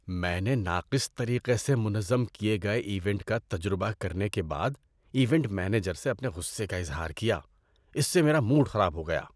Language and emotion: Urdu, disgusted